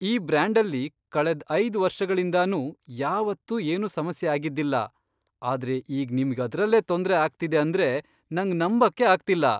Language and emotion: Kannada, surprised